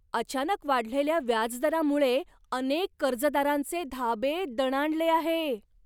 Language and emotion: Marathi, surprised